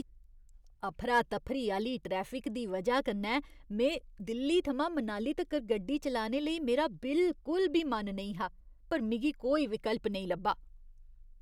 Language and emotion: Dogri, disgusted